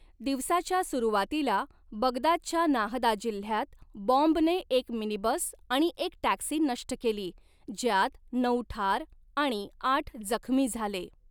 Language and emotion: Marathi, neutral